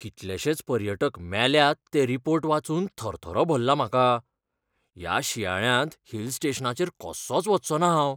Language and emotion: Goan Konkani, fearful